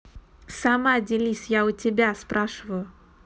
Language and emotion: Russian, angry